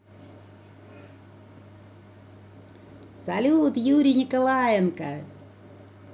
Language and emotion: Russian, positive